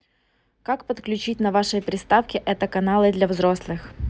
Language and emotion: Russian, neutral